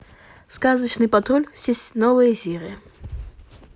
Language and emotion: Russian, neutral